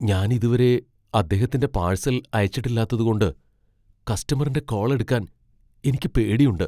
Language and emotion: Malayalam, fearful